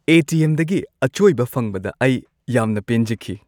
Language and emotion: Manipuri, happy